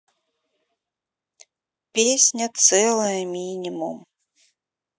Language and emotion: Russian, sad